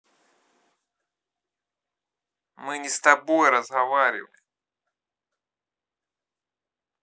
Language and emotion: Russian, angry